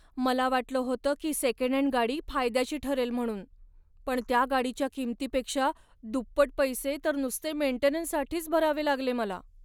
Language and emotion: Marathi, sad